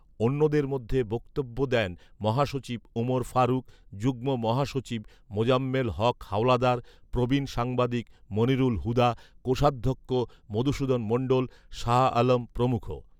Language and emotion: Bengali, neutral